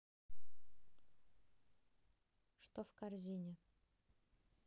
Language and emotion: Russian, neutral